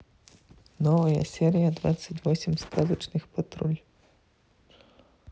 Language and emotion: Russian, neutral